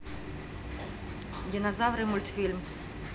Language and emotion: Russian, neutral